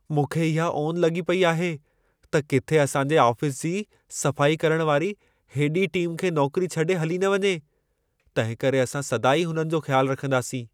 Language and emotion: Sindhi, fearful